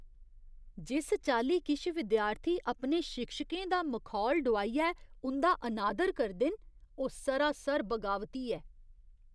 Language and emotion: Dogri, disgusted